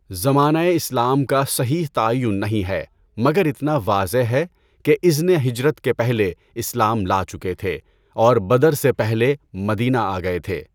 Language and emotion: Urdu, neutral